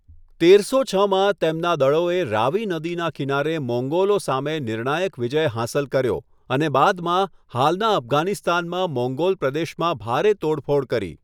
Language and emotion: Gujarati, neutral